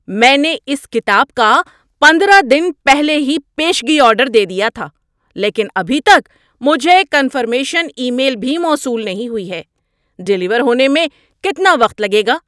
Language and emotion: Urdu, angry